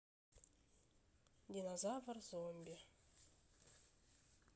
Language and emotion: Russian, neutral